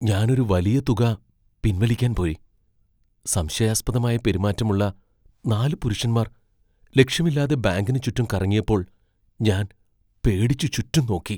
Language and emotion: Malayalam, fearful